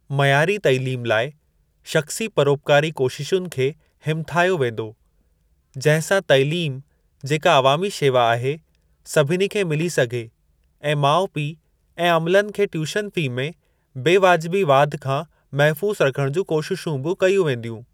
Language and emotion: Sindhi, neutral